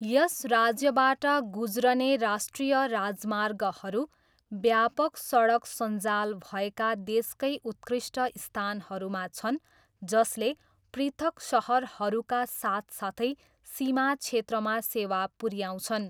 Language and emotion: Nepali, neutral